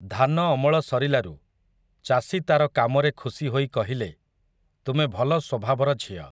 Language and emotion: Odia, neutral